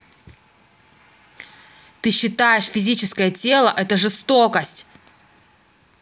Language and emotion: Russian, angry